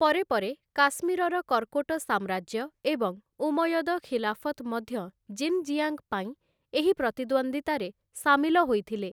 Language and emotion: Odia, neutral